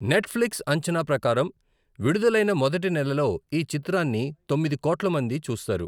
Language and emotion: Telugu, neutral